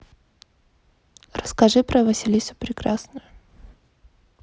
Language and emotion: Russian, neutral